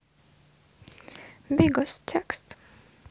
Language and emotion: Russian, sad